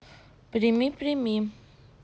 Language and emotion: Russian, neutral